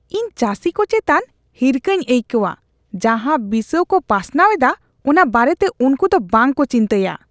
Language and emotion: Santali, disgusted